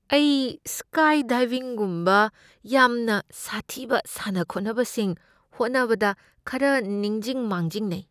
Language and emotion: Manipuri, fearful